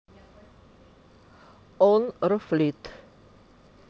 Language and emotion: Russian, neutral